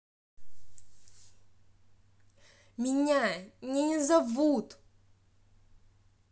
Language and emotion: Russian, angry